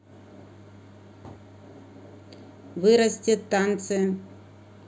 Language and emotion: Russian, neutral